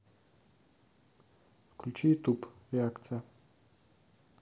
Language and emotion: Russian, neutral